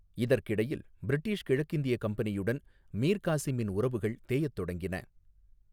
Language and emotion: Tamil, neutral